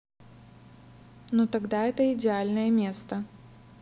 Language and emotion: Russian, neutral